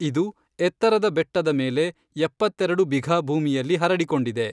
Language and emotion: Kannada, neutral